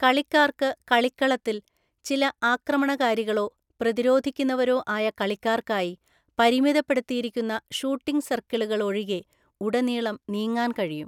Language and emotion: Malayalam, neutral